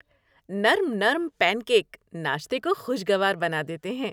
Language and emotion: Urdu, happy